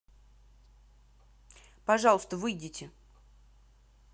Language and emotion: Russian, angry